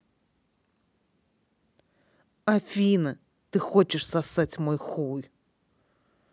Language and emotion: Russian, angry